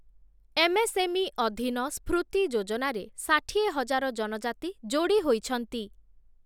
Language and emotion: Odia, neutral